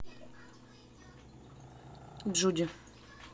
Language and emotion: Russian, neutral